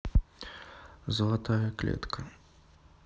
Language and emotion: Russian, neutral